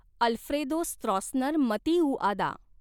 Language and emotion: Marathi, neutral